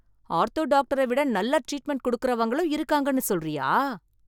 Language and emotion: Tamil, surprised